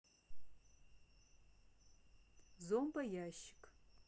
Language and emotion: Russian, neutral